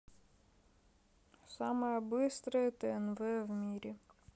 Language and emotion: Russian, neutral